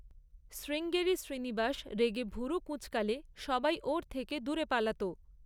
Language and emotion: Bengali, neutral